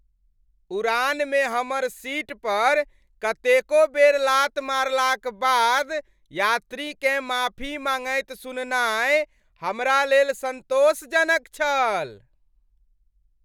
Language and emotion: Maithili, happy